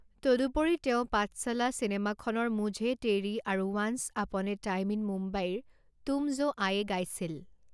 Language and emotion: Assamese, neutral